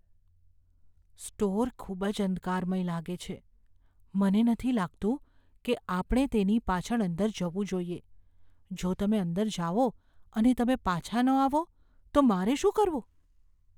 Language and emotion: Gujarati, fearful